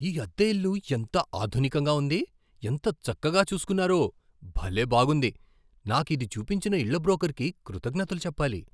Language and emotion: Telugu, surprised